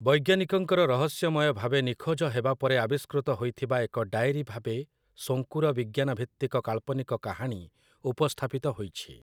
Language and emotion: Odia, neutral